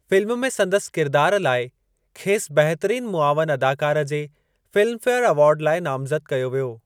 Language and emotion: Sindhi, neutral